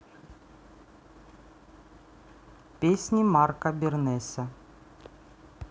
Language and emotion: Russian, neutral